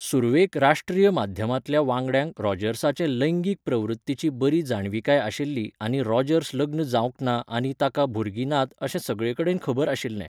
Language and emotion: Goan Konkani, neutral